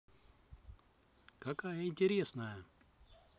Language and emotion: Russian, positive